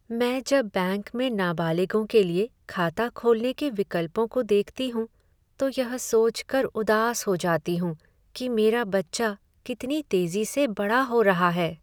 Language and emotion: Hindi, sad